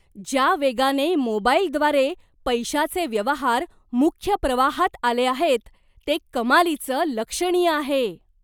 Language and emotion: Marathi, surprised